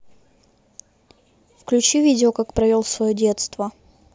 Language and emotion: Russian, neutral